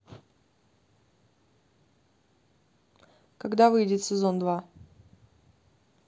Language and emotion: Russian, neutral